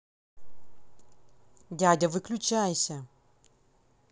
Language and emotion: Russian, angry